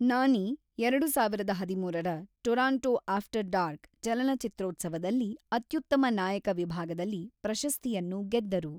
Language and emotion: Kannada, neutral